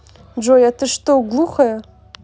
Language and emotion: Russian, angry